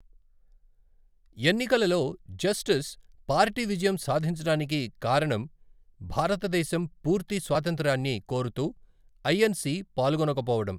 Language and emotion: Telugu, neutral